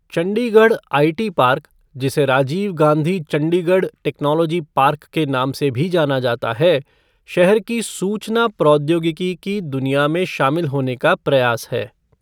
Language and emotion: Hindi, neutral